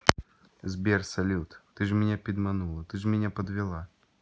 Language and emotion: Russian, neutral